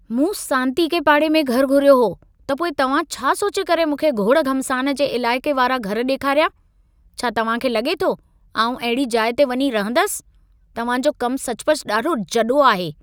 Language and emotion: Sindhi, angry